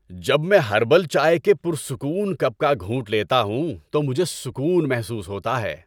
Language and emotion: Urdu, happy